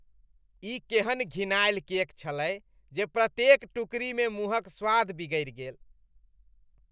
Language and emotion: Maithili, disgusted